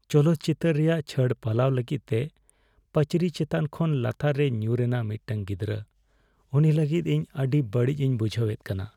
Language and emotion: Santali, sad